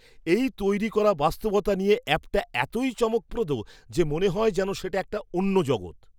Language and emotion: Bengali, surprised